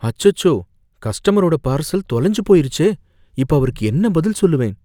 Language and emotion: Tamil, fearful